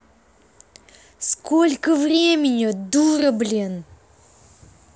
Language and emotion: Russian, angry